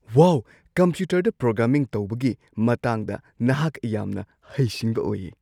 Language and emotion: Manipuri, surprised